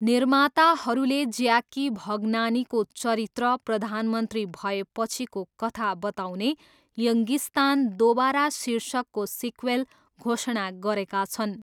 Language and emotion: Nepali, neutral